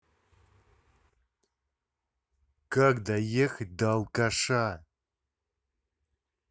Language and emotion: Russian, angry